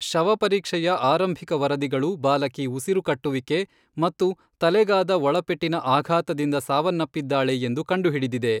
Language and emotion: Kannada, neutral